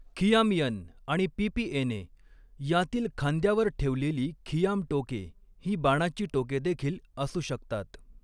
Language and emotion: Marathi, neutral